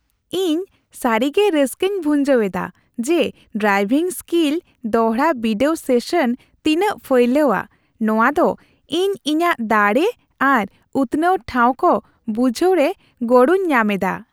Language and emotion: Santali, happy